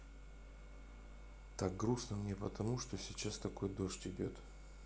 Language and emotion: Russian, sad